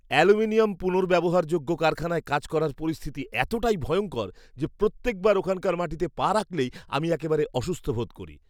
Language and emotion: Bengali, disgusted